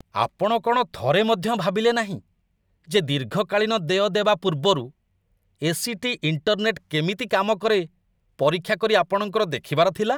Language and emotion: Odia, disgusted